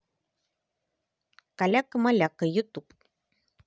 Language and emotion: Russian, positive